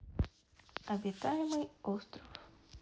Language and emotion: Russian, neutral